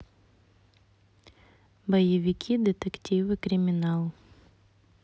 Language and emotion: Russian, neutral